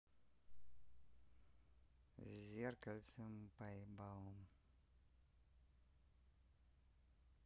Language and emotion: Russian, neutral